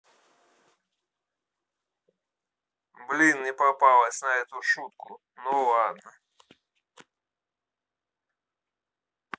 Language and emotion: Russian, sad